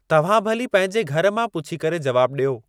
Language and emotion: Sindhi, neutral